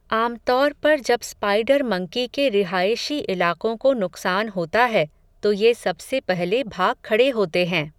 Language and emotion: Hindi, neutral